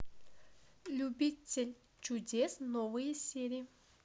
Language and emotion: Russian, neutral